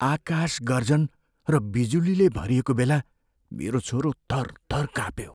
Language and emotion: Nepali, fearful